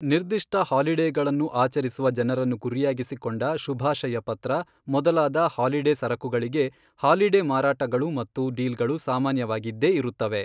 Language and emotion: Kannada, neutral